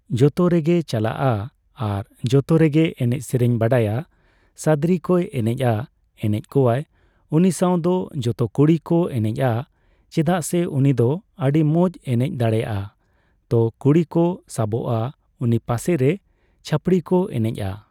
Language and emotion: Santali, neutral